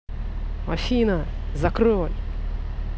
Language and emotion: Russian, angry